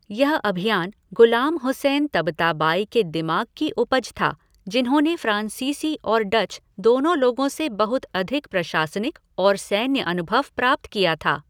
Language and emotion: Hindi, neutral